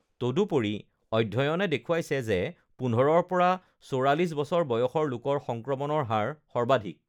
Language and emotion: Assamese, neutral